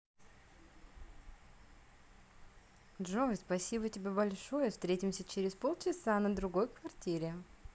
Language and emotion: Russian, positive